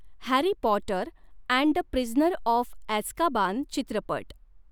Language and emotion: Marathi, neutral